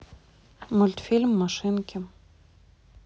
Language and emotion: Russian, neutral